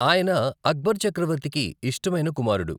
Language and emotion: Telugu, neutral